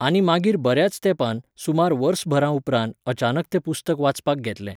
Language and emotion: Goan Konkani, neutral